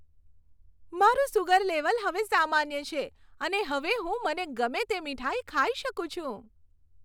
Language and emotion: Gujarati, happy